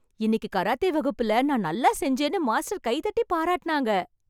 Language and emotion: Tamil, happy